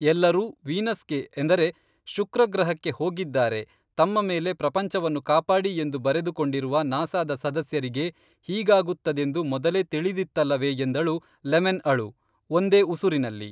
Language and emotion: Kannada, neutral